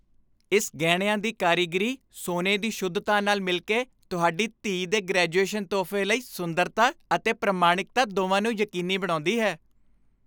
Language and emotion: Punjabi, happy